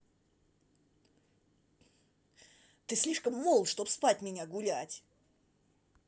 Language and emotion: Russian, angry